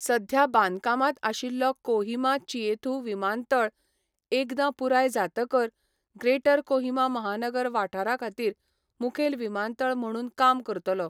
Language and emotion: Goan Konkani, neutral